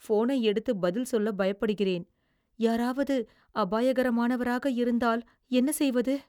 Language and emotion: Tamil, fearful